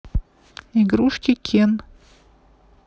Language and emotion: Russian, neutral